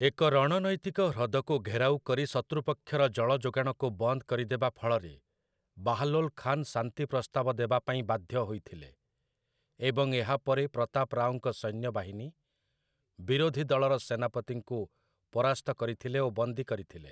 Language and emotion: Odia, neutral